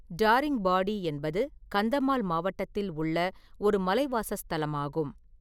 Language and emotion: Tamil, neutral